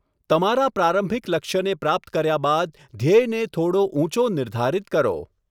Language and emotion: Gujarati, neutral